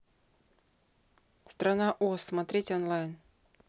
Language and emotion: Russian, neutral